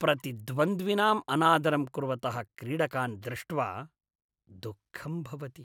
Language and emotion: Sanskrit, disgusted